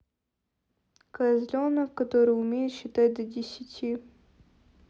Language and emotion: Russian, neutral